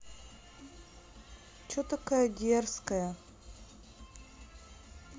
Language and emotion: Russian, neutral